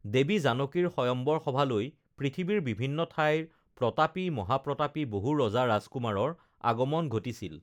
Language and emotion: Assamese, neutral